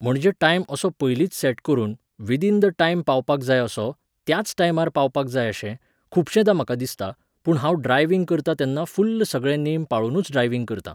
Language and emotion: Goan Konkani, neutral